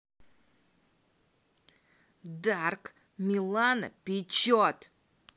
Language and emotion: Russian, angry